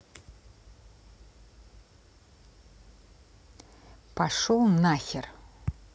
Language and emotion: Russian, angry